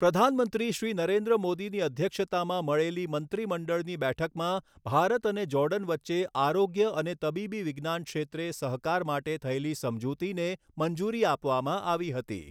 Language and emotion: Gujarati, neutral